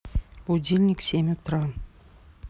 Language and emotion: Russian, neutral